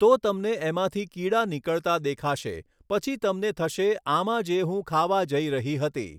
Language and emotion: Gujarati, neutral